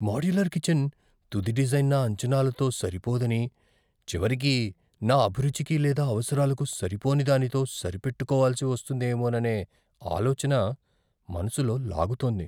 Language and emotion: Telugu, fearful